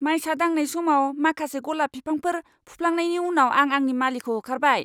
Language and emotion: Bodo, angry